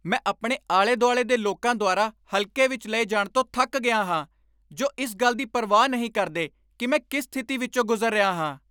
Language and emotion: Punjabi, angry